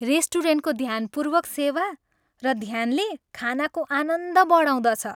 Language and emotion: Nepali, happy